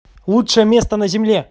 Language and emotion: Russian, positive